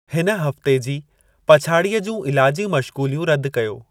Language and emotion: Sindhi, neutral